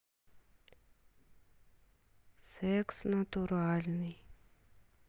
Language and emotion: Russian, neutral